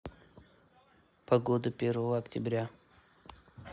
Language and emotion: Russian, neutral